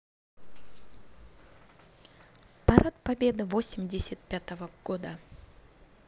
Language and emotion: Russian, positive